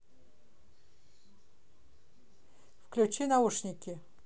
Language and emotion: Russian, neutral